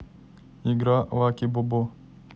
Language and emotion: Russian, neutral